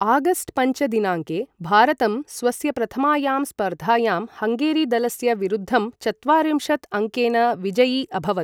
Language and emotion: Sanskrit, neutral